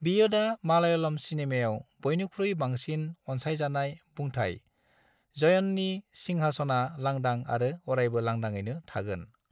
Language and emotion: Bodo, neutral